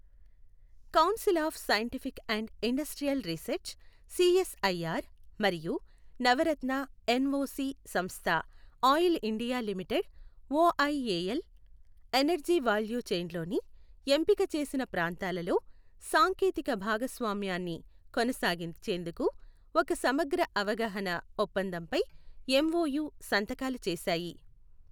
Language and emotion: Telugu, neutral